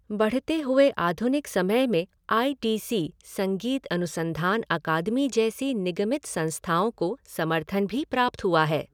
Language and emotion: Hindi, neutral